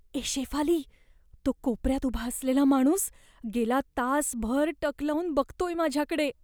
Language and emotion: Marathi, fearful